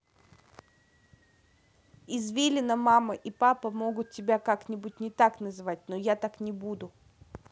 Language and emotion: Russian, neutral